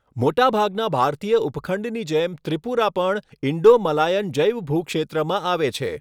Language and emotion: Gujarati, neutral